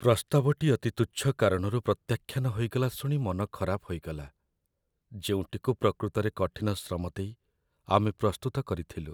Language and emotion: Odia, sad